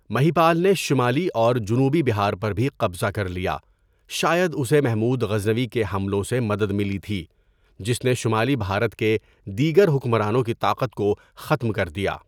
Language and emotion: Urdu, neutral